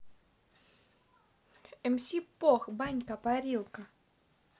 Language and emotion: Russian, positive